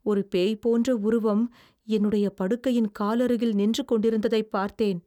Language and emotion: Tamil, fearful